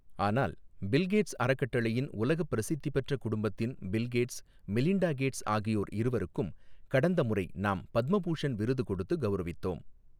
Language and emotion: Tamil, neutral